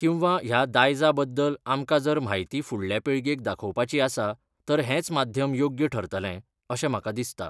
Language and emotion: Goan Konkani, neutral